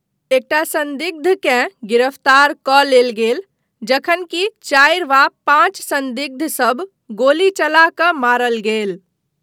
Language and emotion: Maithili, neutral